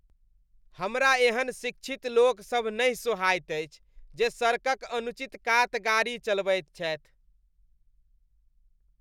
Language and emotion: Maithili, disgusted